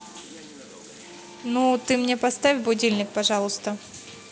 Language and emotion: Russian, neutral